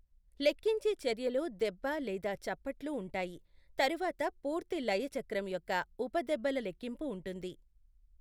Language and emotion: Telugu, neutral